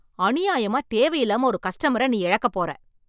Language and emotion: Tamil, angry